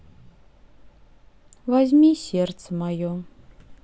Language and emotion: Russian, sad